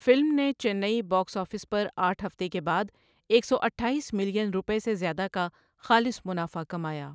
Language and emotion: Urdu, neutral